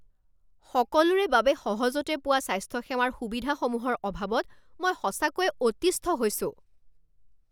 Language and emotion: Assamese, angry